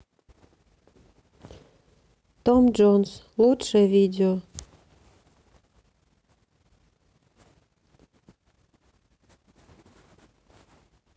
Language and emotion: Russian, sad